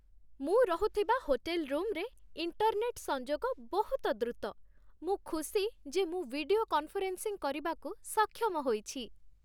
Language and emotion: Odia, happy